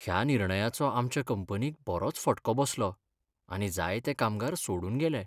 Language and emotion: Goan Konkani, sad